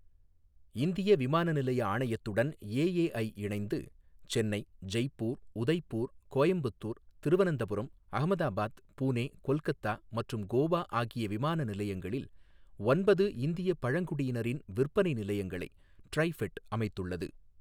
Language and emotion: Tamil, neutral